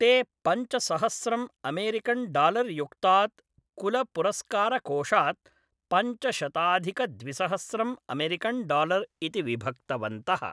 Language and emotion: Sanskrit, neutral